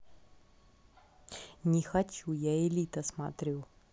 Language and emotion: Russian, neutral